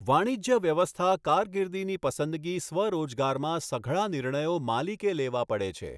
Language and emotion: Gujarati, neutral